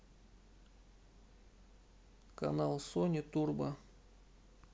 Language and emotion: Russian, neutral